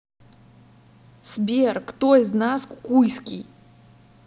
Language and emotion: Russian, angry